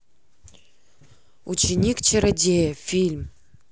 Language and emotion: Russian, neutral